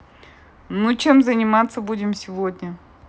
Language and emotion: Russian, neutral